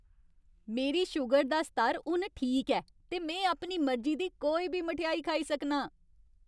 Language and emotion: Dogri, happy